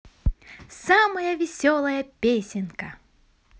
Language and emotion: Russian, positive